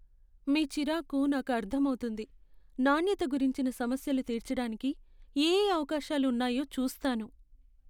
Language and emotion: Telugu, sad